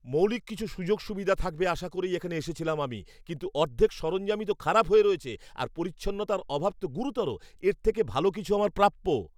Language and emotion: Bengali, angry